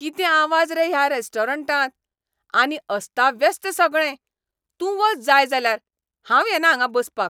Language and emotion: Goan Konkani, angry